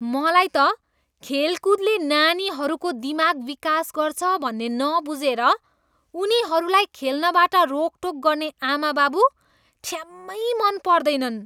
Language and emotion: Nepali, disgusted